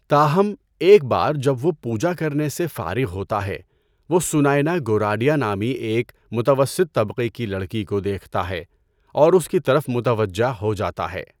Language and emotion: Urdu, neutral